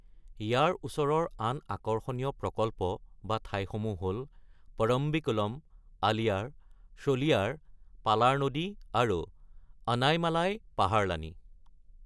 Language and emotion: Assamese, neutral